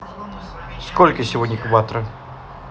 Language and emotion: Russian, neutral